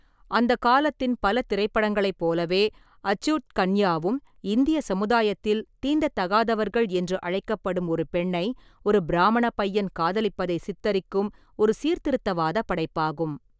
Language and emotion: Tamil, neutral